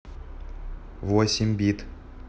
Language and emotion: Russian, neutral